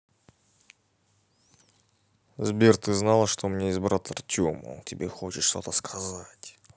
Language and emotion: Russian, neutral